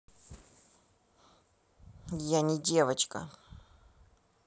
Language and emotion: Russian, angry